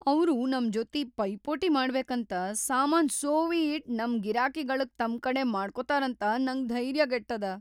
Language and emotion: Kannada, fearful